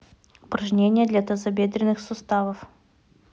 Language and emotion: Russian, neutral